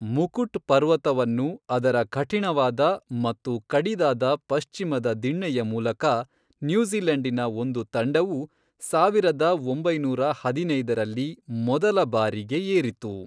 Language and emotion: Kannada, neutral